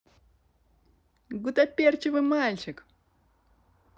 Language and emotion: Russian, positive